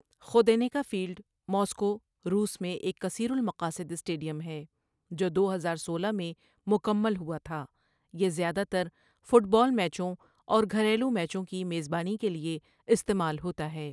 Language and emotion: Urdu, neutral